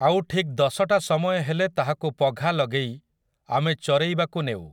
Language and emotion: Odia, neutral